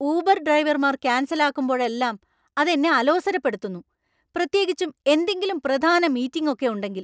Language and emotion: Malayalam, angry